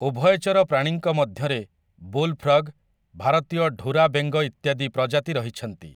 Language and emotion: Odia, neutral